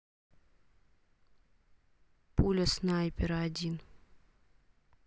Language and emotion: Russian, neutral